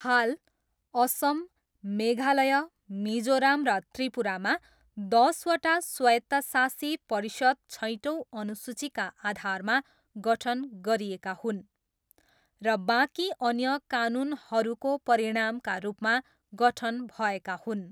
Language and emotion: Nepali, neutral